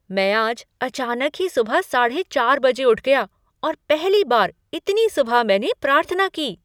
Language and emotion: Hindi, surprised